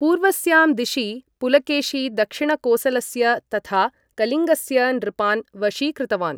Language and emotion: Sanskrit, neutral